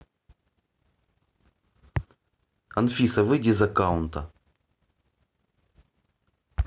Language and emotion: Russian, angry